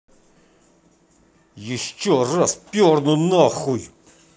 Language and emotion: Russian, angry